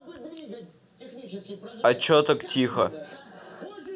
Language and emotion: Russian, neutral